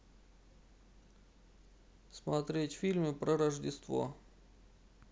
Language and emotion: Russian, neutral